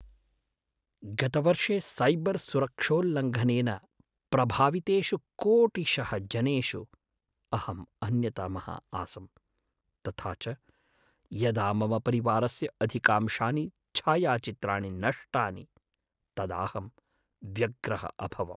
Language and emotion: Sanskrit, sad